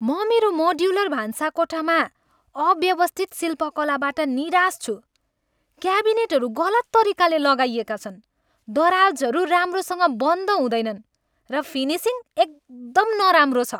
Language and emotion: Nepali, angry